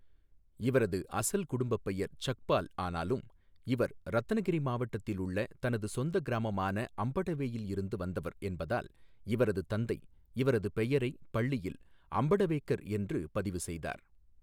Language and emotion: Tamil, neutral